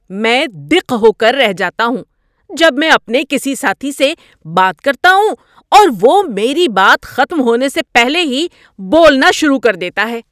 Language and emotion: Urdu, angry